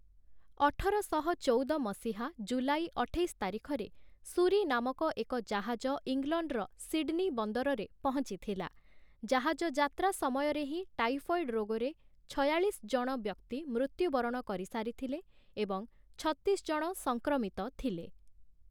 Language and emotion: Odia, neutral